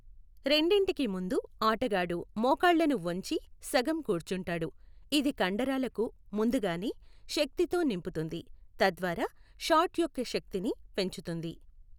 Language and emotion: Telugu, neutral